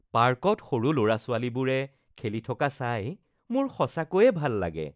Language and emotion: Assamese, happy